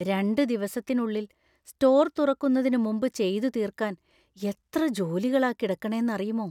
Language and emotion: Malayalam, fearful